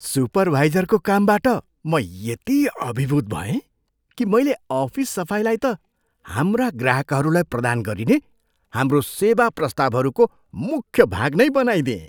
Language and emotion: Nepali, surprised